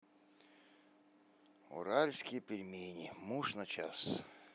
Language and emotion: Russian, neutral